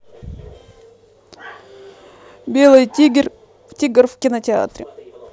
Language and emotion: Russian, neutral